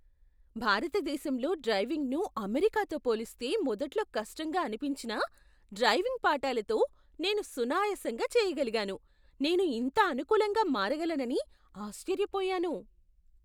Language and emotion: Telugu, surprised